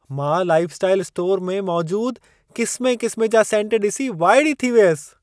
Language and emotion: Sindhi, surprised